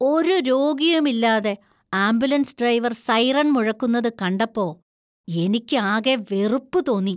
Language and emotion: Malayalam, disgusted